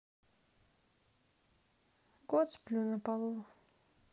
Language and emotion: Russian, sad